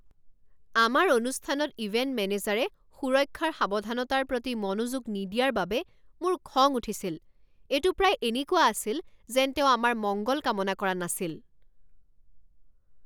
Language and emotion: Assamese, angry